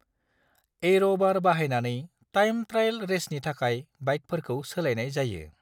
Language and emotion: Bodo, neutral